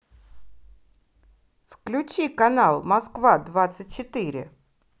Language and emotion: Russian, positive